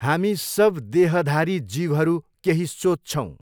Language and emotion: Nepali, neutral